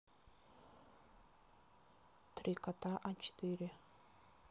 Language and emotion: Russian, neutral